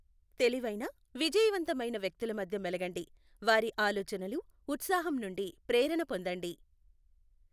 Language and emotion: Telugu, neutral